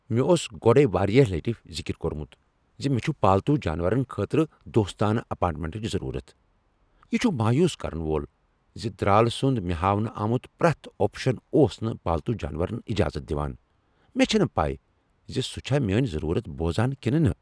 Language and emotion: Kashmiri, angry